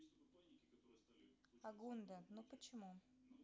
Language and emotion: Russian, neutral